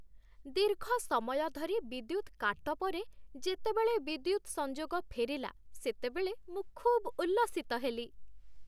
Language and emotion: Odia, happy